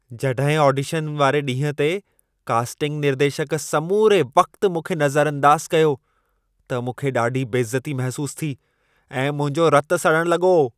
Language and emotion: Sindhi, angry